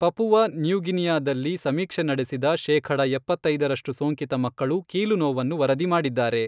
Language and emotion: Kannada, neutral